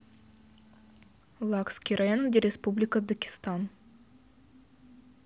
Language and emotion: Russian, neutral